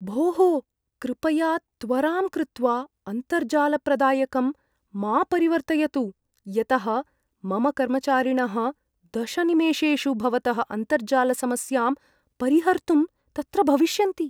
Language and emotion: Sanskrit, fearful